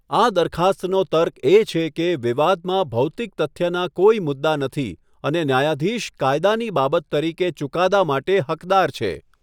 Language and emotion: Gujarati, neutral